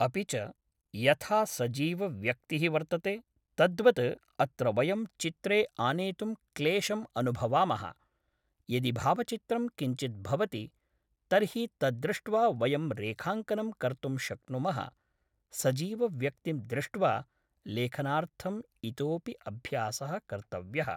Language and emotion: Sanskrit, neutral